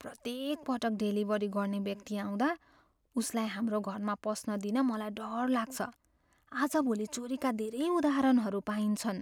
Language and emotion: Nepali, fearful